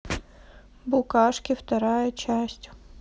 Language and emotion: Russian, neutral